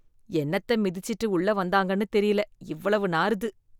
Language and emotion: Tamil, disgusted